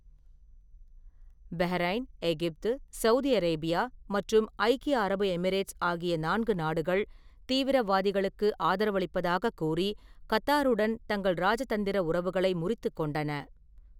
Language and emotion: Tamil, neutral